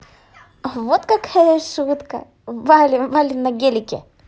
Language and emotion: Russian, positive